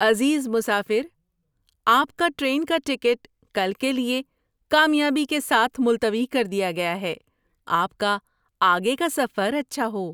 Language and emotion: Urdu, happy